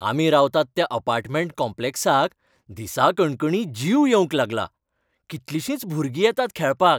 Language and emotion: Goan Konkani, happy